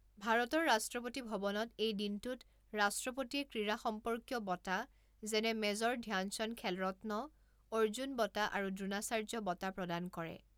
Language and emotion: Assamese, neutral